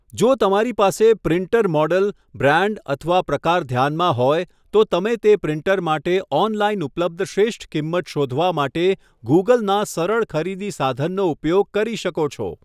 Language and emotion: Gujarati, neutral